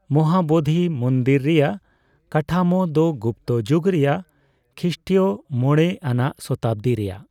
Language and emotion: Santali, neutral